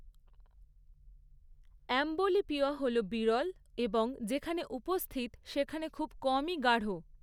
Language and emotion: Bengali, neutral